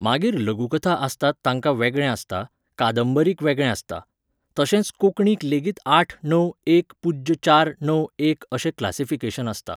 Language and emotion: Goan Konkani, neutral